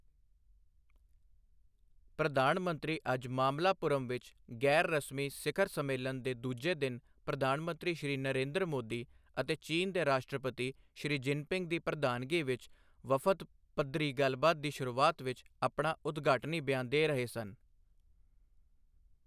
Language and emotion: Punjabi, neutral